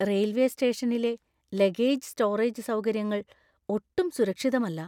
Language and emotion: Malayalam, fearful